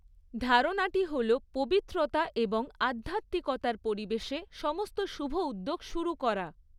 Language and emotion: Bengali, neutral